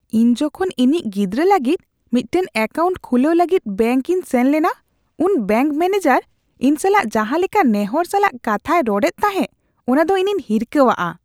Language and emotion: Santali, disgusted